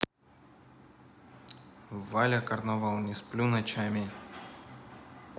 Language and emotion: Russian, neutral